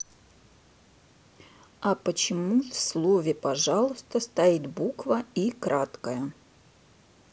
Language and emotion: Russian, neutral